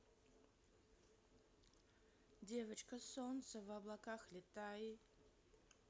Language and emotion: Russian, positive